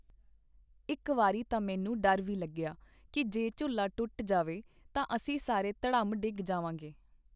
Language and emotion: Punjabi, neutral